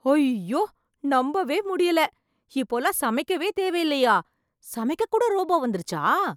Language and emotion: Tamil, surprised